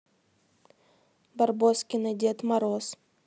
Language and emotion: Russian, neutral